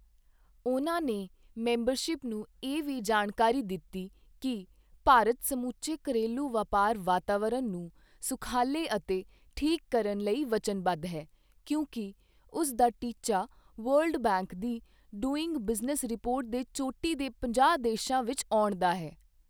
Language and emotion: Punjabi, neutral